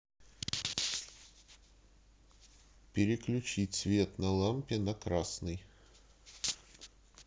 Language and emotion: Russian, neutral